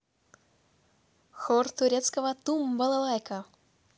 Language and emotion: Russian, positive